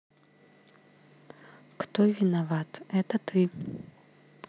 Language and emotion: Russian, neutral